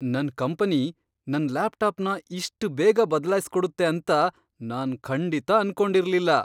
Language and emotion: Kannada, surprised